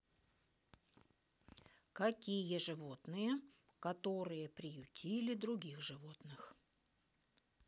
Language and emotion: Russian, neutral